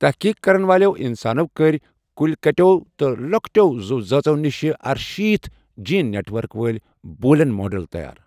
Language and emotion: Kashmiri, neutral